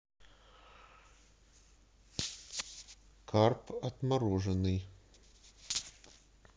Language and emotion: Russian, neutral